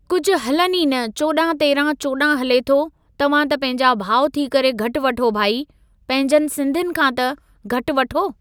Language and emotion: Sindhi, neutral